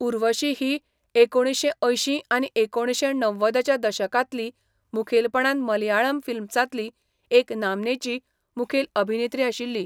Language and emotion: Goan Konkani, neutral